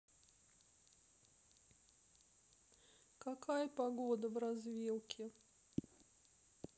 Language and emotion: Russian, sad